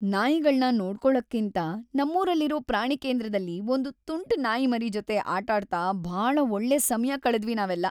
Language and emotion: Kannada, happy